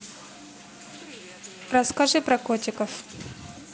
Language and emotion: Russian, neutral